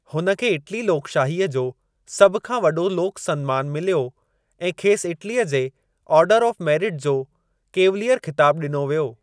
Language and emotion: Sindhi, neutral